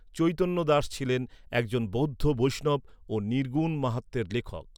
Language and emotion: Bengali, neutral